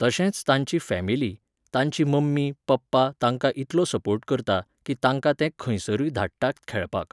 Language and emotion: Goan Konkani, neutral